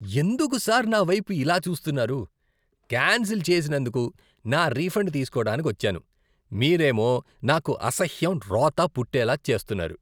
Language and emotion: Telugu, disgusted